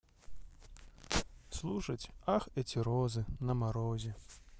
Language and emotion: Russian, sad